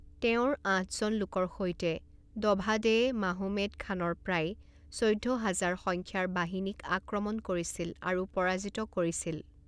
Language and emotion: Assamese, neutral